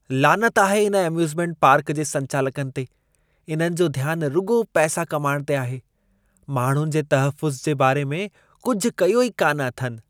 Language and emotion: Sindhi, disgusted